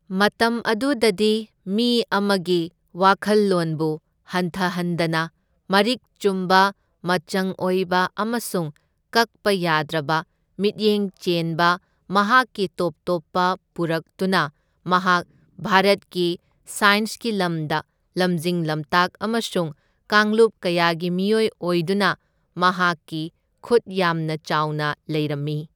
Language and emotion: Manipuri, neutral